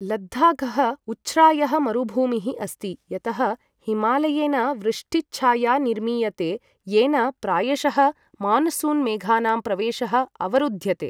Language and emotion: Sanskrit, neutral